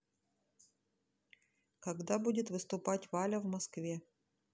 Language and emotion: Russian, neutral